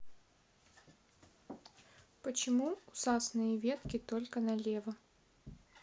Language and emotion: Russian, neutral